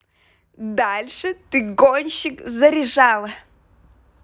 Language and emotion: Russian, positive